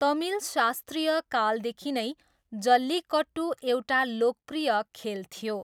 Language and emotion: Nepali, neutral